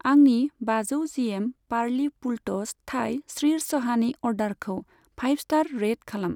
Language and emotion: Bodo, neutral